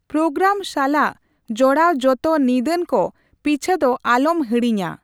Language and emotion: Santali, neutral